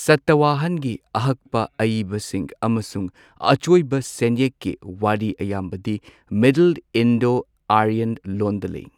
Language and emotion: Manipuri, neutral